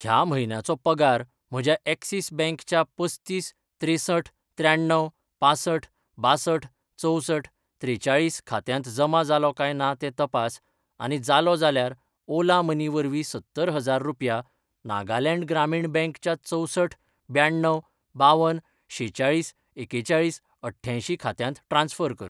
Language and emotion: Goan Konkani, neutral